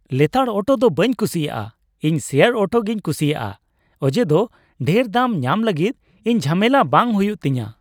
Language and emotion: Santali, happy